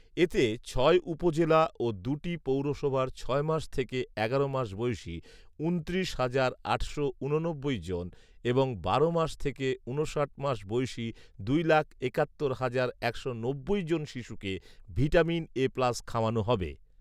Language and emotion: Bengali, neutral